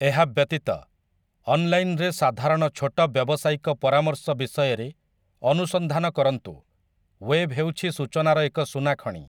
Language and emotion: Odia, neutral